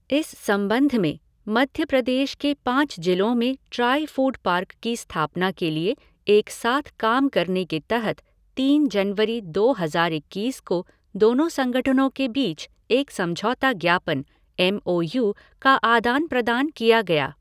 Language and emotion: Hindi, neutral